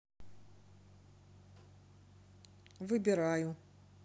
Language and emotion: Russian, neutral